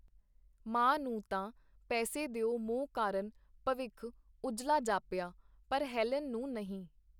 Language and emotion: Punjabi, neutral